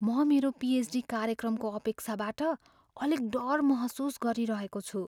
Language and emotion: Nepali, fearful